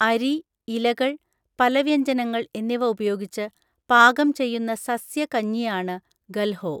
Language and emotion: Malayalam, neutral